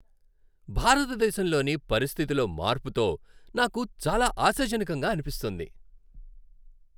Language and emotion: Telugu, happy